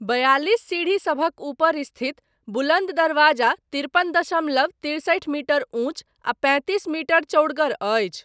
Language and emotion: Maithili, neutral